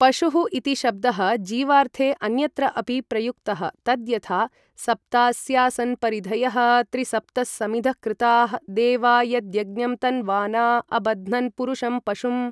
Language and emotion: Sanskrit, neutral